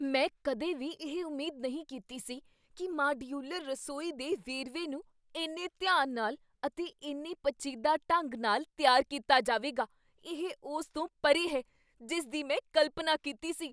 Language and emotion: Punjabi, surprised